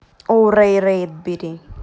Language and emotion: Russian, neutral